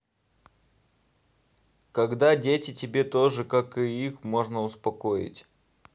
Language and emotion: Russian, neutral